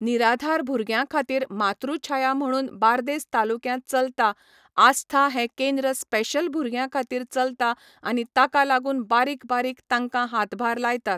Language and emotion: Goan Konkani, neutral